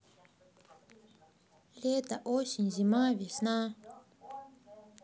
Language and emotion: Russian, neutral